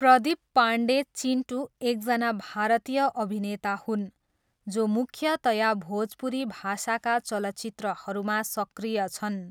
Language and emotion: Nepali, neutral